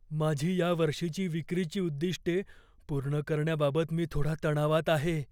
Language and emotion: Marathi, fearful